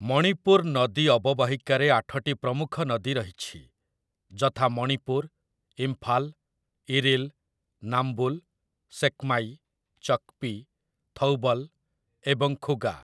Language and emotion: Odia, neutral